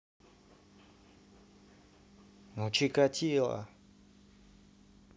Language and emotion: Russian, neutral